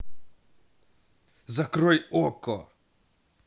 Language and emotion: Russian, angry